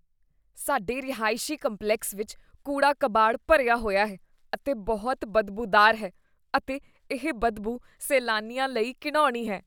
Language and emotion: Punjabi, disgusted